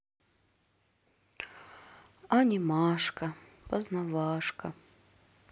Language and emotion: Russian, sad